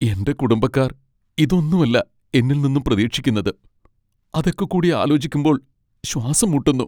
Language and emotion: Malayalam, sad